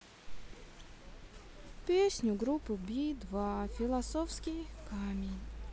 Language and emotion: Russian, sad